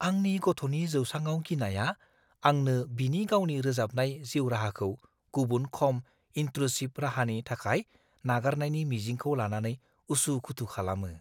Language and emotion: Bodo, fearful